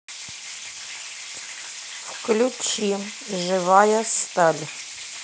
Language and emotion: Russian, neutral